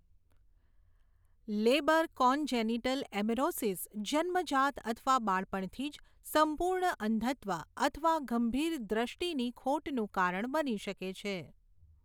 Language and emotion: Gujarati, neutral